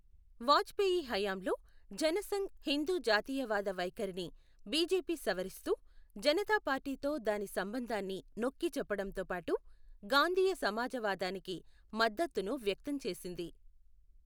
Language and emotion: Telugu, neutral